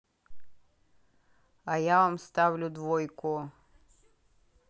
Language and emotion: Russian, angry